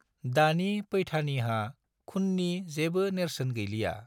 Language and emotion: Bodo, neutral